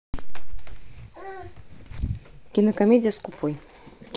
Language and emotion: Russian, neutral